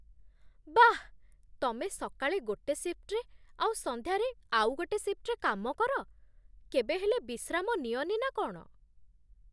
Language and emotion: Odia, surprised